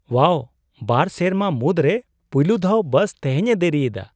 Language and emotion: Santali, surprised